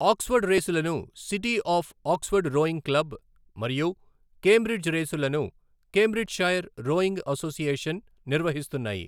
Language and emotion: Telugu, neutral